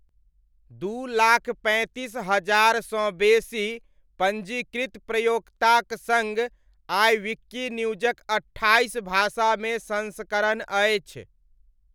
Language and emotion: Maithili, neutral